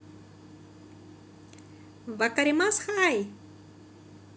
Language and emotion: Russian, positive